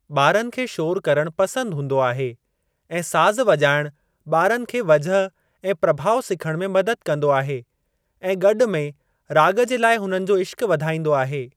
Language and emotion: Sindhi, neutral